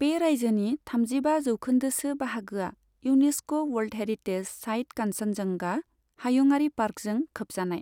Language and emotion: Bodo, neutral